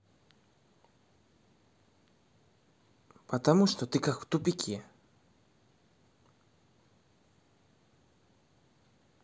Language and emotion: Russian, angry